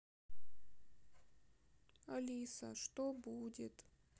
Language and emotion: Russian, sad